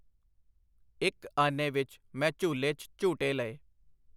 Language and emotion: Punjabi, neutral